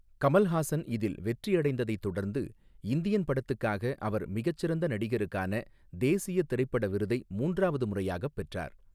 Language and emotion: Tamil, neutral